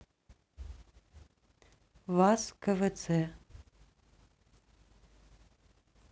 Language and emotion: Russian, neutral